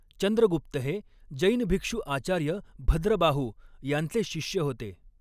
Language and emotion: Marathi, neutral